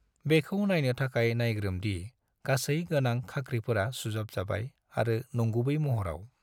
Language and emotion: Bodo, neutral